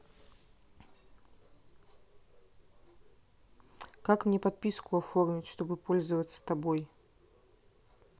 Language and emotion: Russian, neutral